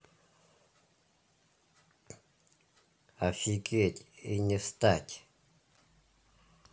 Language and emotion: Russian, neutral